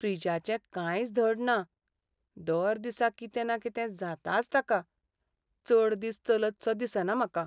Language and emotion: Goan Konkani, sad